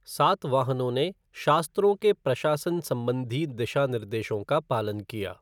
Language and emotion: Hindi, neutral